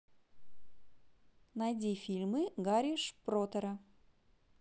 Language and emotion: Russian, positive